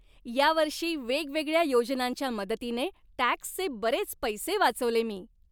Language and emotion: Marathi, happy